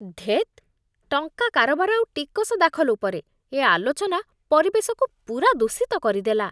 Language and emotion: Odia, disgusted